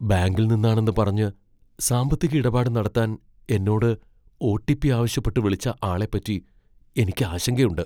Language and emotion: Malayalam, fearful